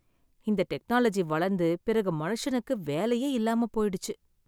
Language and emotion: Tamil, sad